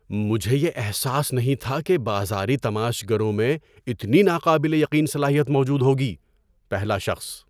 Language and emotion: Urdu, surprised